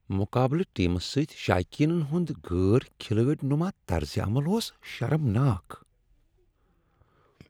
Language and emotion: Kashmiri, disgusted